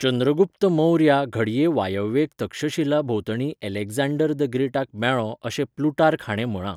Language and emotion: Goan Konkani, neutral